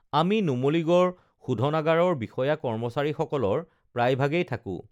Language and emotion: Assamese, neutral